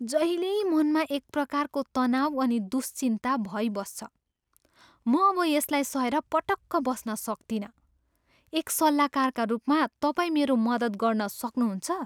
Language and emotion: Nepali, disgusted